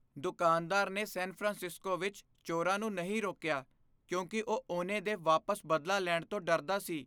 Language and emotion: Punjabi, fearful